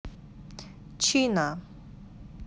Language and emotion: Russian, neutral